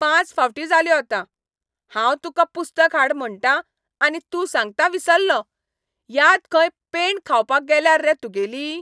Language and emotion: Goan Konkani, angry